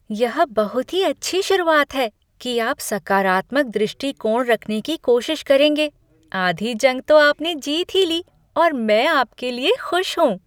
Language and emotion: Hindi, happy